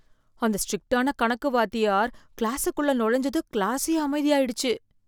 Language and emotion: Tamil, fearful